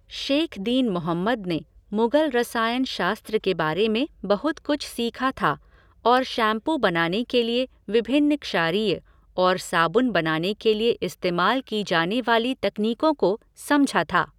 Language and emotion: Hindi, neutral